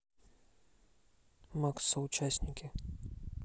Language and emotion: Russian, neutral